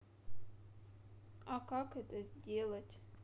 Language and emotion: Russian, sad